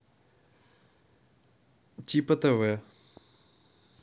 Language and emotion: Russian, neutral